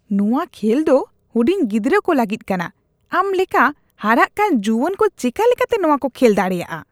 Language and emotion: Santali, disgusted